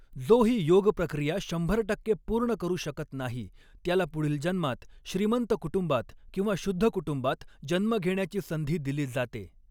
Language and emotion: Marathi, neutral